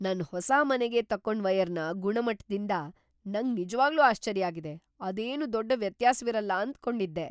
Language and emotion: Kannada, surprised